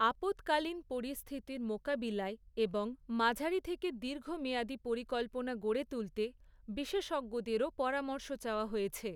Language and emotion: Bengali, neutral